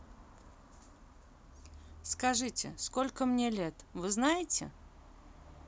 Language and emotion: Russian, neutral